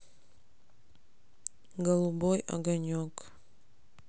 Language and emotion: Russian, sad